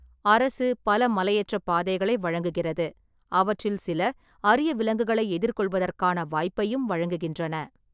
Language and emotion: Tamil, neutral